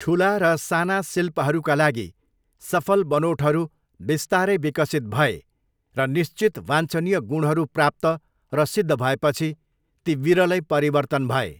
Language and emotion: Nepali, neutral